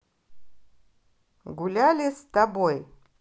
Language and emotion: Russian, positive